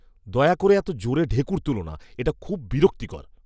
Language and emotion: Bengali, disgusted